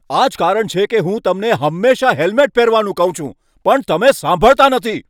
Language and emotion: Gujarati, angry